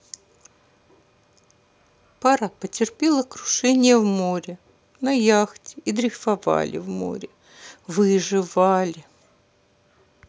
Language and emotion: Russian, sad